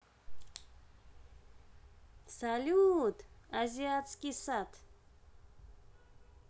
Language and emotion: Russian, positive